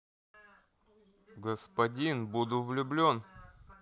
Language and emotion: Russian, neutral